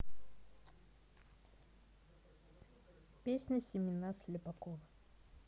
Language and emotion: Russian, neutral